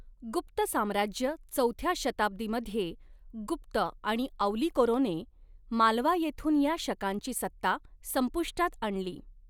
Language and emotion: Marathi, neutral